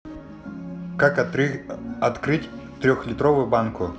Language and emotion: Russian, neutral